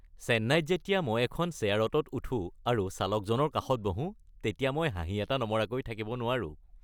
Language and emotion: Assamese, happy